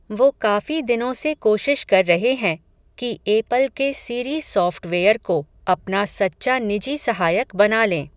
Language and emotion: Hindi, neutral